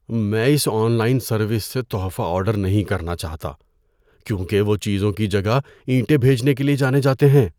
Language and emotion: Urdu, fearful